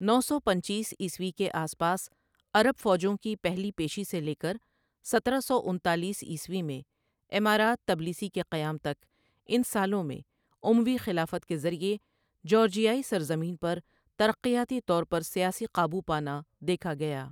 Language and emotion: Urdu, neutral